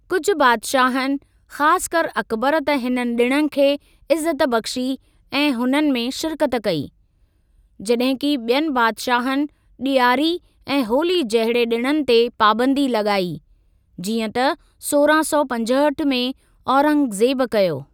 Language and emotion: Sindhi, neutral